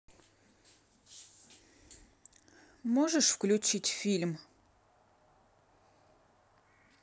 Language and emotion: Russian, neutral